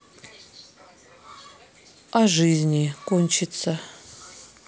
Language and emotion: Russian, sad